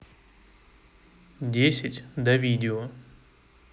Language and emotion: Russian, neutral